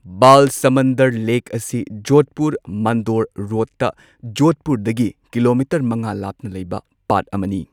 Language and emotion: Manipuri, neutral